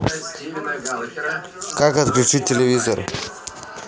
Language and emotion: Russian, neutral